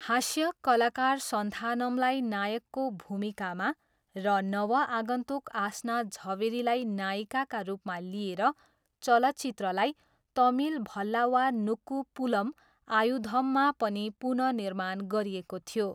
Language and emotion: Nepali, neutral